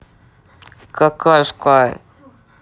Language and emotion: Russian, angry